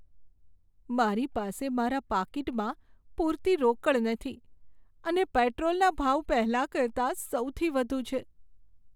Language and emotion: Gujarati, sad